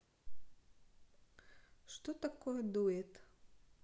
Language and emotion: Russian, neutral